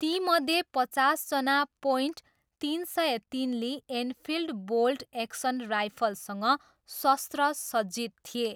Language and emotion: Nepali, neutral